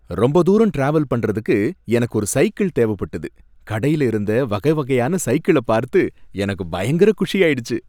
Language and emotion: Tamil, happy